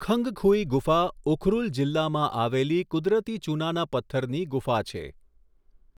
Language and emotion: Gujarati, neutral